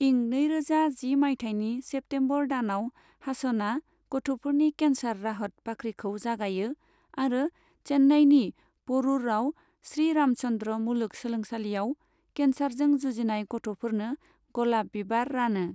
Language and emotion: Bodo, neutral